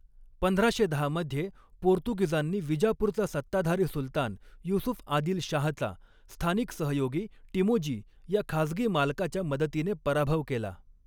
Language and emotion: Marathi, neutral